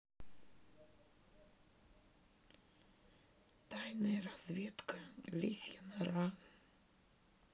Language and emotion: Russian, sad